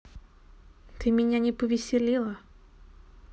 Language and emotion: Russian, neutral